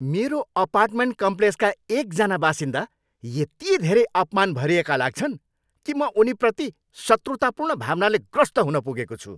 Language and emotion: Nepali, angry